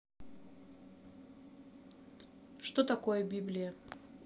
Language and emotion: Russian, neutral